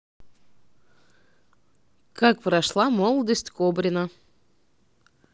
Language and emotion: Russian, neutral